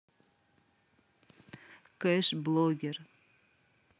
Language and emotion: Russian, neutral